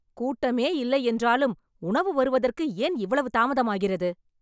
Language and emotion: Tamil, angry